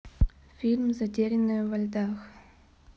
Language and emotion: Russian, neutral